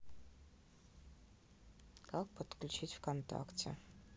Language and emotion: Russian, neutral